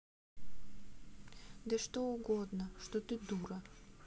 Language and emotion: Russian, sad